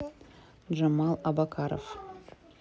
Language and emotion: Russian, neutral